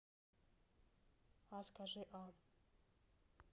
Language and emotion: Russian, neutral